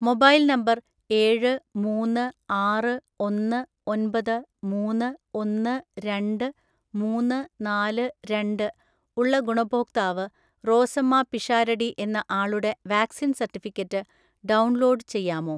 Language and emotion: Malayalam, neutral